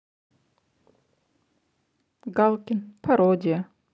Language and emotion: Russian, neutral